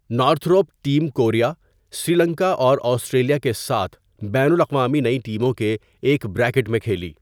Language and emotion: Urdu, neutral